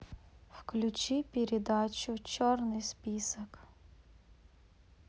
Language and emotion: Russian, sad